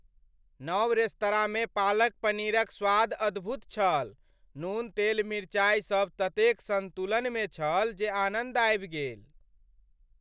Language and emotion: Maithili, happy